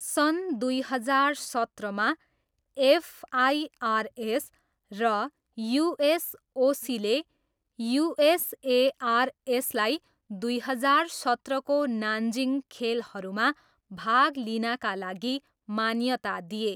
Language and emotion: Nepali, neutral